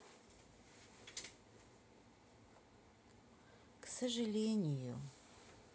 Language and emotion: Russian, sad